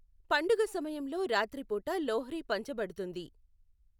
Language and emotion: Telugu, neutral